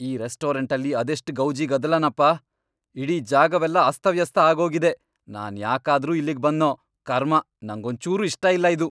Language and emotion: Kannada, angry